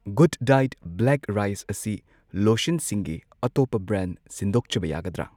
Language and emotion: Manipuri, neutral